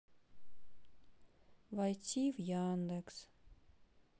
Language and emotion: Russian, sad